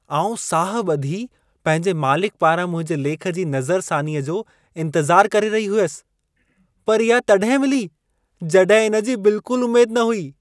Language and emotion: Sindhi, surprised